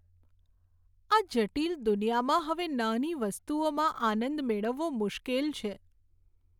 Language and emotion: Gujarati, sad